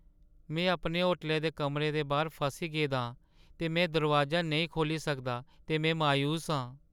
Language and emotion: Dogri, sad